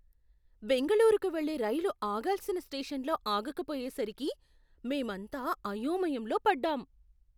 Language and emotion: Telugu, surprised